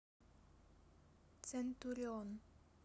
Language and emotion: Russian, neutral